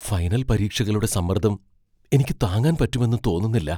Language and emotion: Malayalam, fearful